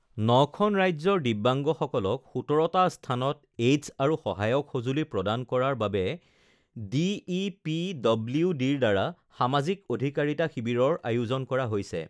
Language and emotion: Assamese, neutral